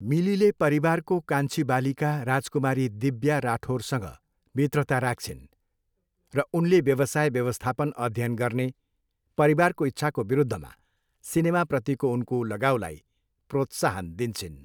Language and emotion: Nepali, neutral